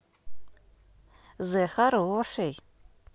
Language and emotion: Russian, positive